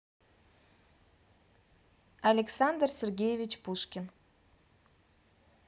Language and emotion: Russian, neutral